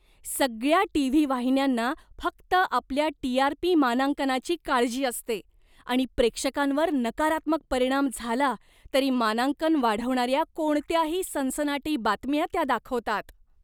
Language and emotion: Marathi, disgusted